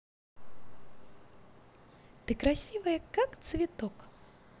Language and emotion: Russian, positive